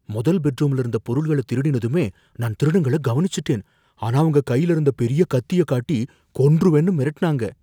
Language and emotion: Tamil, fearful